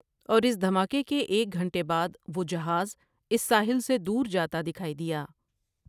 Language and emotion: Urdu, neutral